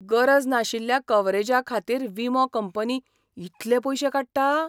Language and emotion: Goan Konkani, surprised